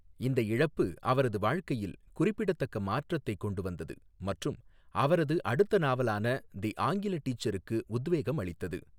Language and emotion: Tamil, neutral